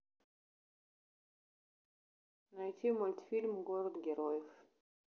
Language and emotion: Russian, neutral